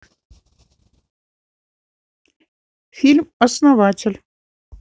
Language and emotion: Russian, neutral